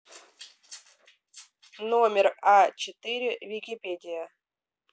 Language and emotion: Russian, neutral